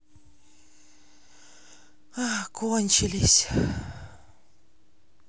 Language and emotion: Russian, sad